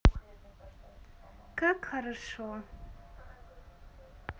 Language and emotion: Russian, positive